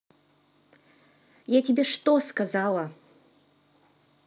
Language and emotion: Russian, angry